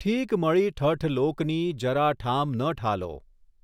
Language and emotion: Gujarati, neutral